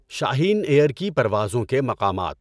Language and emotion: Urdu, neutral